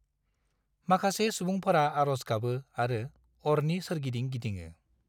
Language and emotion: Bodo, neutral